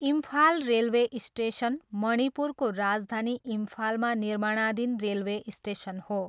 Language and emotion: Nepali, neutral